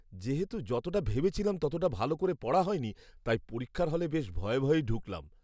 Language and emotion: Bengali, fearful